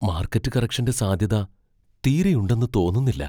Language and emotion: Malayalam, fearful